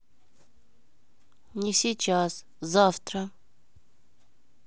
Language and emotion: Russian, neutral